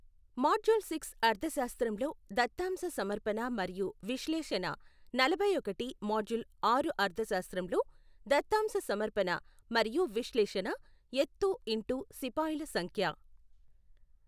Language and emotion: Telugu, neutral